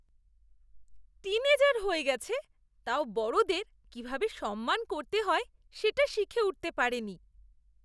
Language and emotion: Bengali, disgusted